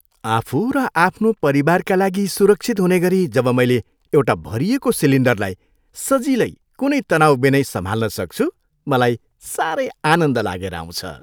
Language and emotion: Nepali, happy